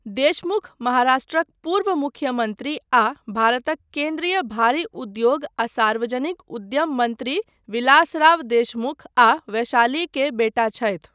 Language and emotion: Maithili, neutral